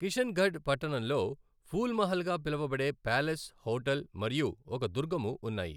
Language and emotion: Telugu, neutral